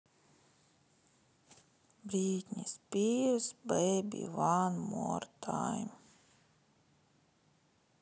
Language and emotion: Russian, sad